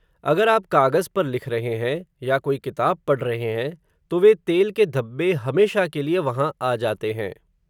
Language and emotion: Hindi, neutral